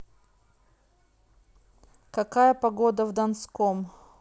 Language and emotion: Russian, neutral